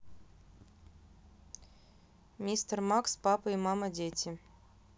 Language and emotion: Russian, neutral